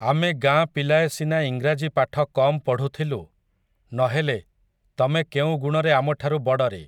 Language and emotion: Odia, neutral